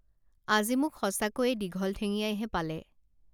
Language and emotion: Assamese, neutral